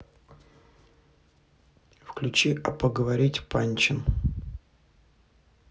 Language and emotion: Russian, neutral